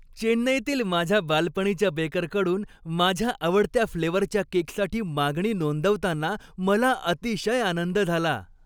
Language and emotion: Marathi, happy